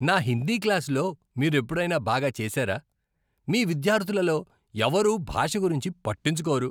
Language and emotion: Telugu, disgusted